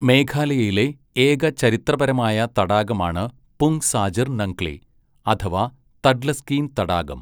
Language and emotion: Malayalam, neutral